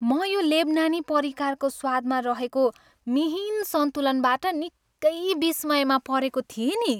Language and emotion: Nepali, happy